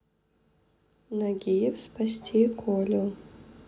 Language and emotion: Russian, neutral